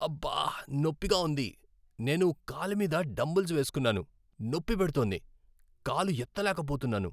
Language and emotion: Telugu, sad